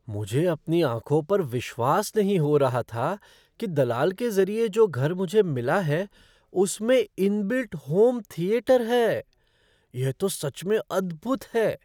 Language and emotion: Hindi, surprised